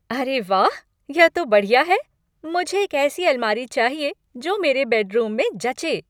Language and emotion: Hindi, happy